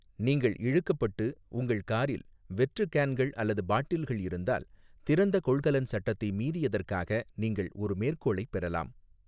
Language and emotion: Tamil, neutral